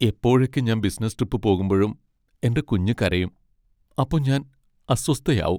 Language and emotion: Malayalam, sad